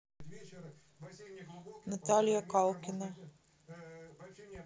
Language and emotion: Russian, neutral